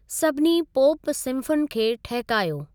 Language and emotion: Sindhi, neutral